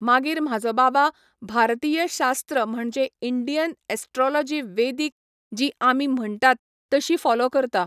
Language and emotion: Goan Konkani, neutral